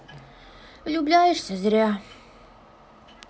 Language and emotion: Russian, sad